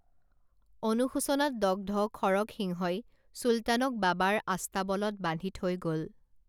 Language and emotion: Assamese, neutral